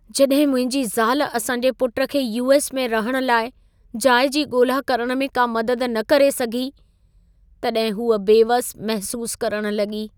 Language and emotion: Sindhi, sad